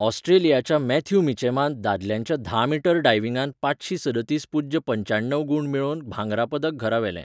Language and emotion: Goan Konkani, neutral